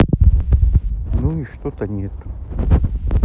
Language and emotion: Russian, sad